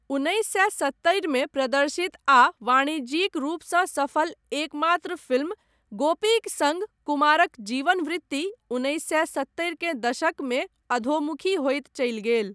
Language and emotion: Maithili, neutral